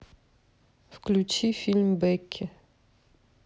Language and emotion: Russian, neutral